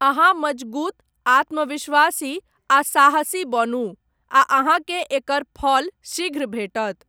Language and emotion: Maithili, neutral